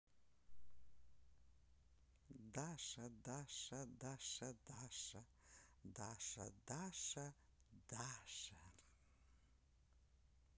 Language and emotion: Russian, neutral